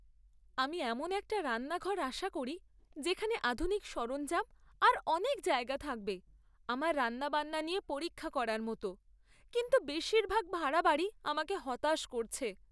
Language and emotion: Bengali, sad